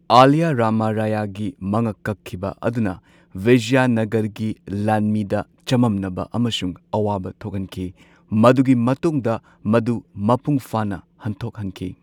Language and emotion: Manipuri, neutral